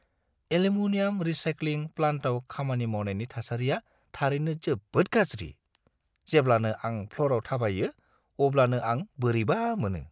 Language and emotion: Bodo, disgusted